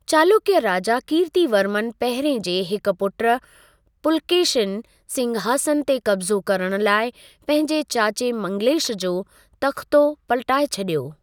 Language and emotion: Sindhi, neutral